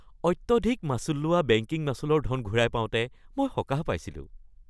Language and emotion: Assamese, happy